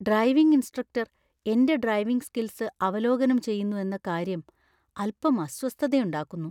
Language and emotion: Malayalam, fearful